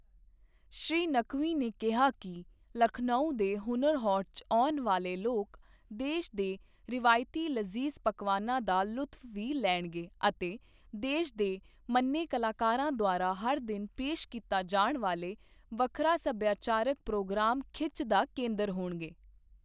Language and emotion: Punjabi, neutral